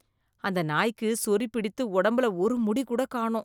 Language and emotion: Tamil, disgusted